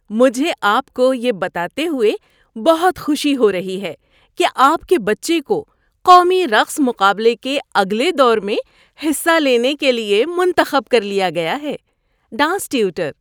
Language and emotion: Urdu, happy